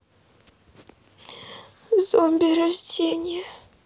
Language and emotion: Russian, sad